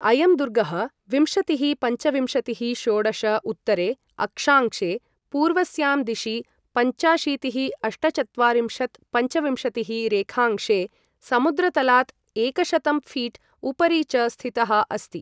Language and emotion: Sanskrit, neutral